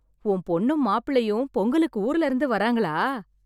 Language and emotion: Tamil, happy